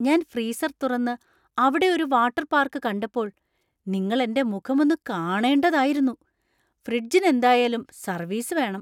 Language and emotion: Malayalam, surprised